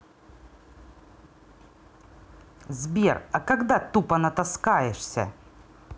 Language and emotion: Russian, angry